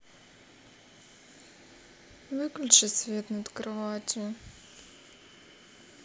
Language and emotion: Russian, sad